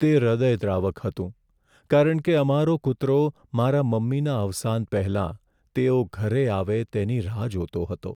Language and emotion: Gujarati, sad